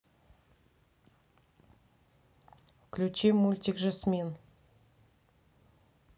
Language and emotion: Russian, neutral